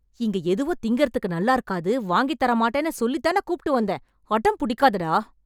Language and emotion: Tamil, angry